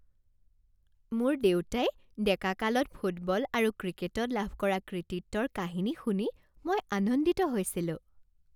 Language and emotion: Assamese, happy